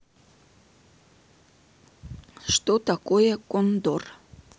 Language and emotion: Russian, neutral